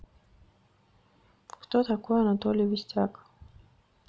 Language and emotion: Russian, neutral